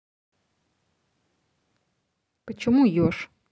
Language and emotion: Russian, neutral